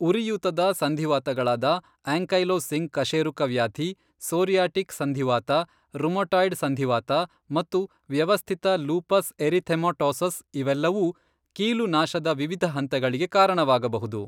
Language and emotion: Kannada, neutral